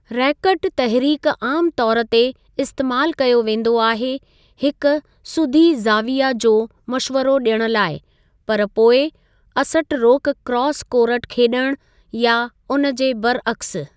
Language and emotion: Sindhi, neutral